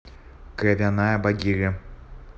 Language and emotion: Russian, neutral